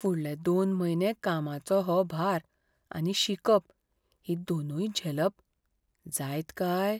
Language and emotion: Goan Konkani, fearful